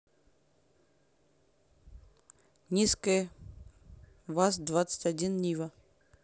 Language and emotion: Russian, neutral